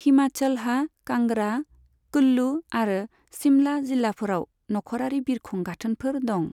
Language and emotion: Bodo, neutral